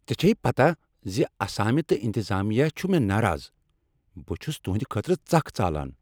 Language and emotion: Kashmiri, angry